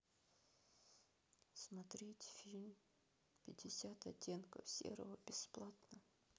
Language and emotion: Russian, sad